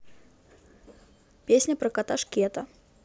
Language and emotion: Russian, neutral